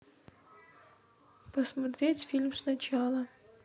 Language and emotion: Russian, sad